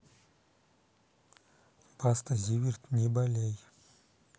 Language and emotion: Russian, neutral